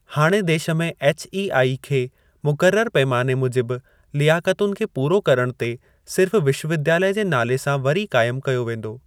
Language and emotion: Sindhi, neutral